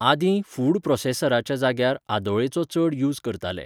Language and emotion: Goan Konkani, neutral